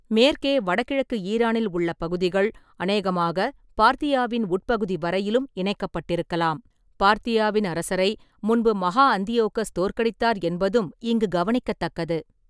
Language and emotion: Tamil, neutral